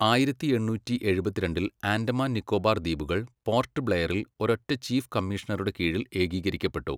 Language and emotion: Malayalam, neutral